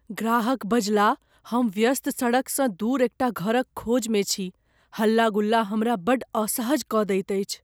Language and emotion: Maithili, fearful